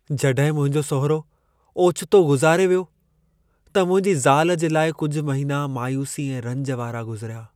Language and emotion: Sindhi, sad